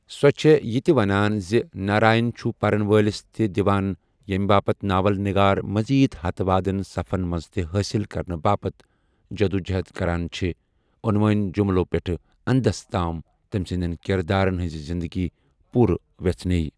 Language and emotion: Kashmiri, neutral